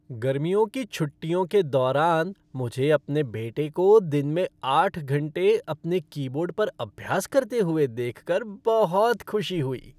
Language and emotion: Hindi, happy